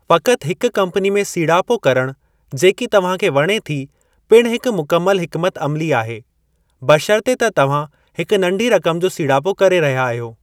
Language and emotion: Sindhi, neutral